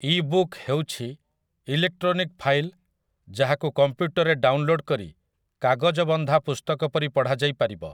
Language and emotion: Odia, neutral